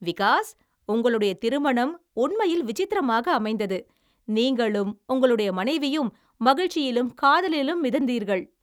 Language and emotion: Tamil, happy